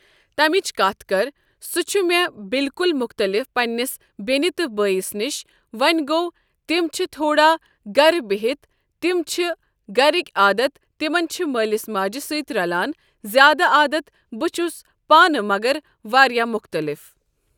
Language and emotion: Kashmiri, neutral